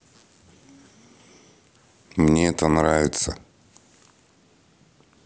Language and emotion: Russian, neutral